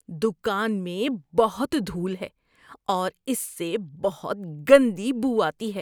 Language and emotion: Urdu, disgusted